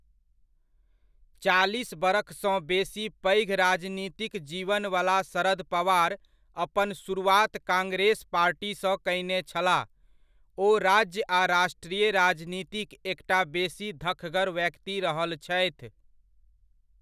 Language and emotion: Maithili, neutral